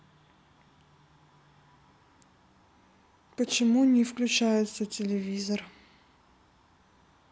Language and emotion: Russian, neutral